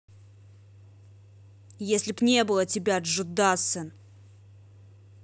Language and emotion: Russian, angry